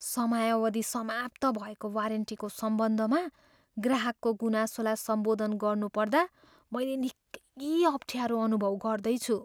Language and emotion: Nepali, fearful